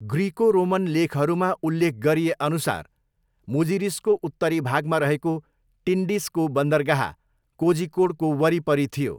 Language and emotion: Nepali, neutral